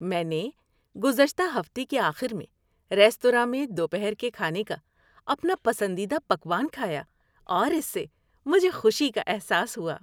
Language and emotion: Urdu, happy